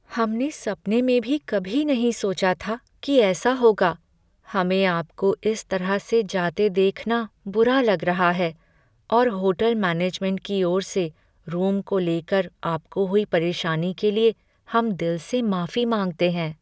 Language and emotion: Hindi, sad